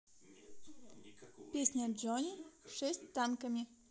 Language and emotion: Russian, positive